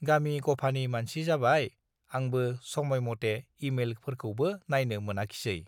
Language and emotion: Bodo, neutral